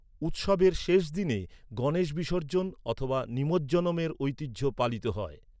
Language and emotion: Bengali, neutral